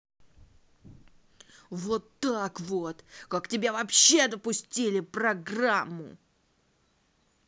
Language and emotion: Russian, angry